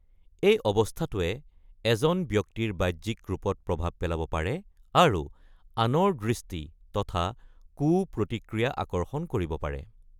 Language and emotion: Assamese, neutral